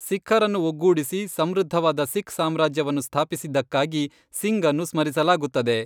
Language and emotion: Kannada, neutral